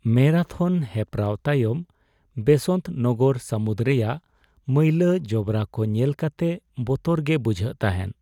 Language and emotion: Santali, sad